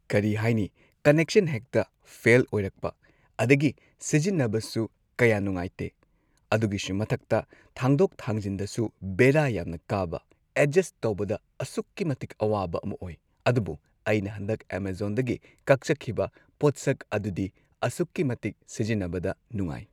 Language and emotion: Manipuri, neutral